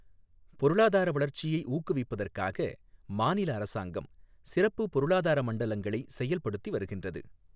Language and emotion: Tamil, neutral